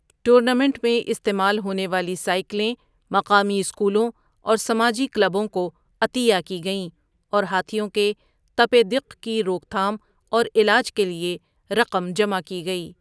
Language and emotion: Urdu, neutral